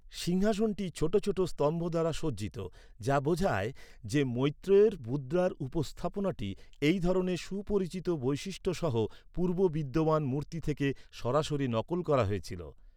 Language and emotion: Bengali, neutral